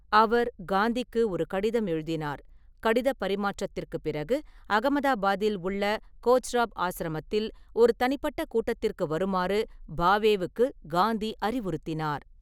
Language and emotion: Tamil, neutral